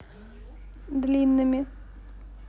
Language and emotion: Russian, neutral